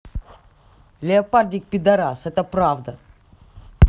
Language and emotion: Russian, angry